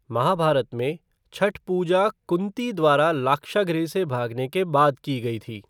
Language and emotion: Hindi, neutral